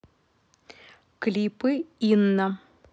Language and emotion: Russian, neutral